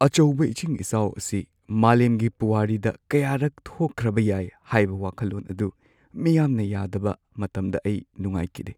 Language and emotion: Manipuri, sad